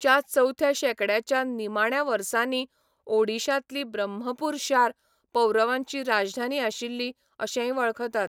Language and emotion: Goan Konkani, neutral